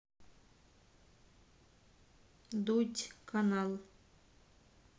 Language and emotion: Russian, neutral